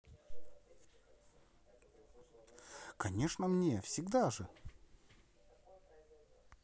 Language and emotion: Russian, positive